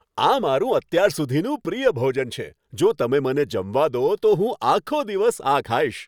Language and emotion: Gujarati, happy